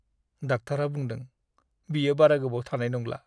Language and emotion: Bodo, sad